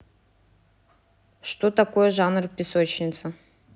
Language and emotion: Russian, neutral